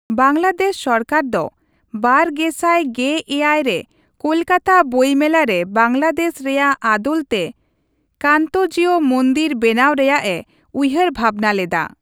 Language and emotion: Santali, neutral